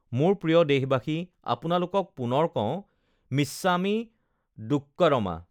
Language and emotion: Assamese, neutral